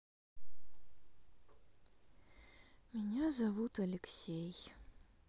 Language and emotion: Russian, sad